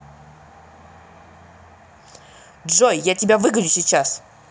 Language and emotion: Russian, angry